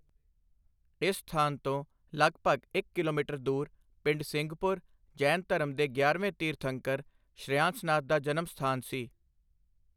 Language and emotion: Punjabi, neutral